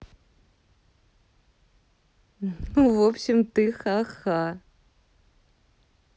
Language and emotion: Russian, positive